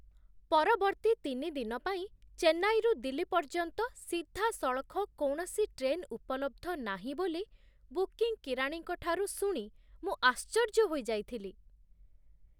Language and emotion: Odia, surprised